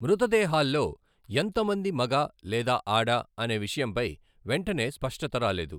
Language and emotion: Telugu, neutral